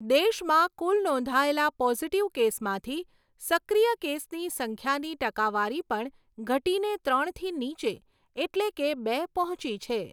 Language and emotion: Gujarati, neutral